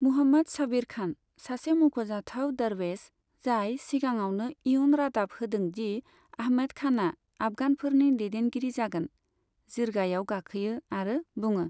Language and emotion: Bodo, neutral